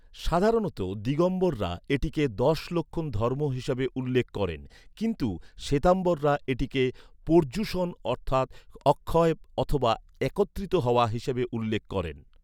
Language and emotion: Bengali, neutral